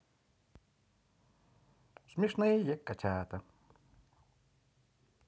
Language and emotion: Russian, positive